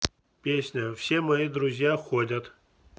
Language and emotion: Russian, neutral